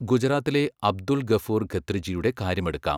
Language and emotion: Malayalam, neutral